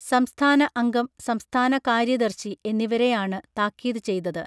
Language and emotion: Malayalam, neutral